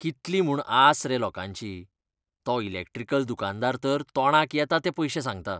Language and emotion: Goan Konkani, disgusted